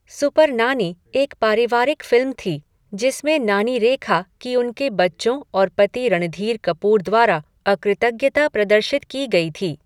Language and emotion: Hindi, neutral